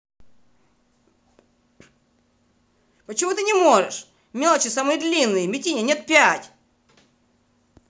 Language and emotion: Russian, angry